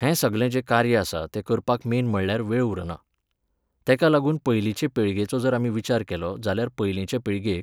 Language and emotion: Goan Konkani, neutral